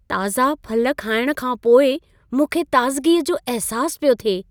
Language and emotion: Sindhi, happy